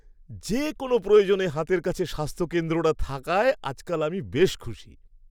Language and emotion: Bengali, happy